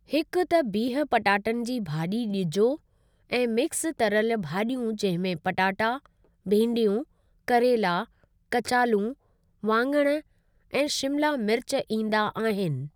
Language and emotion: Sindhi, neutral